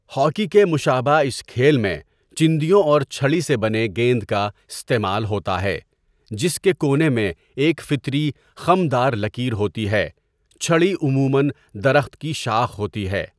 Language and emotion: Urdu, neutral